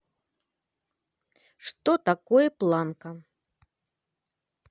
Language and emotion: Russian, neutral